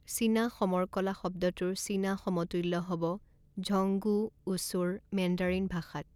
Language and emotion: Assamese, neutral